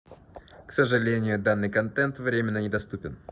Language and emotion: Russian, neutral